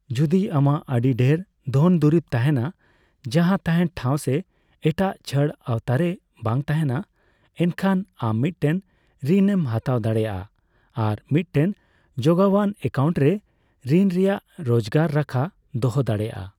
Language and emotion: Santali, neutral